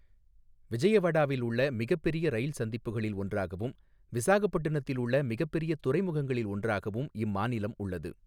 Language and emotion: Tamil, neutral